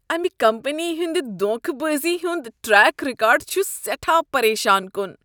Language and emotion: Kashmiri, disgusted